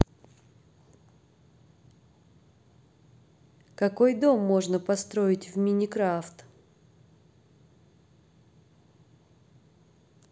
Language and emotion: Russian, neutral